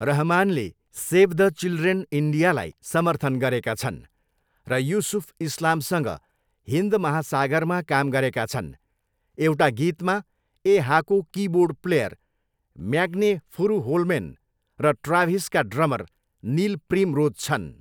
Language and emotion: Nepali, neutral